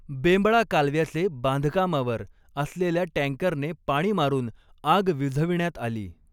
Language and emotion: Marathi, neutral